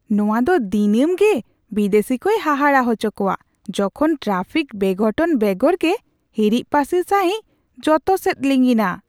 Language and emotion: Santali, surprised